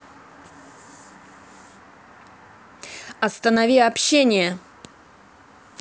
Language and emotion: Russian, angry